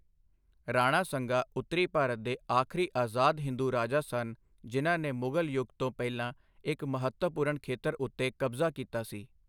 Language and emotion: Punjabi, neutral